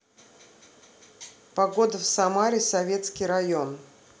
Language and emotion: Russian, neutral